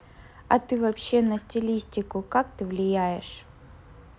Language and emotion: Russian, neutral